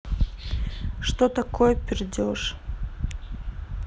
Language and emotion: Russian, neutral